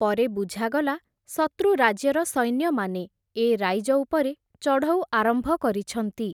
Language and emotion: Odia, neutral